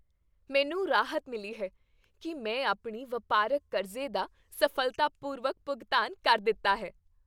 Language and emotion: Punjabi, happy